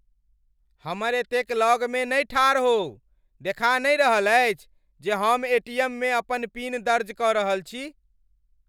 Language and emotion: Maithili, angry